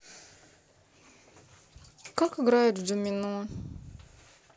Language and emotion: Russian, sad